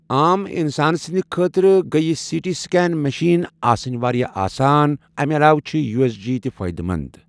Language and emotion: Kashmiri, neutral